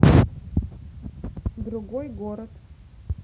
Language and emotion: Russian, neutral